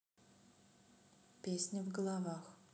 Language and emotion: Russian, neutral